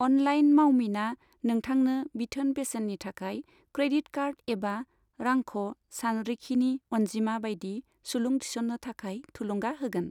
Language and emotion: Bodo, neutral